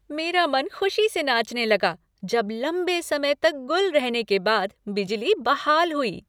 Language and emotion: Hindi, happy